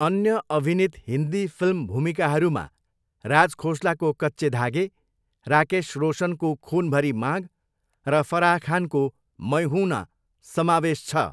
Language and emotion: Nepali, neutral